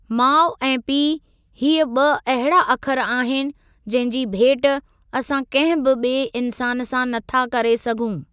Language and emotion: Sindhi, neutral